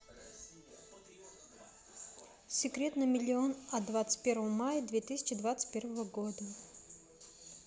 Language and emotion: Russian, neutral